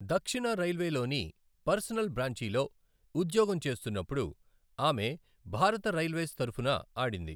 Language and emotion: Telugu, neutral